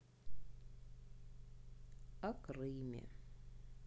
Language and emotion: Russian, sad